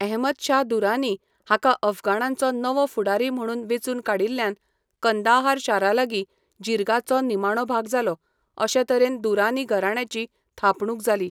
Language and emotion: Goan Konkani, neutral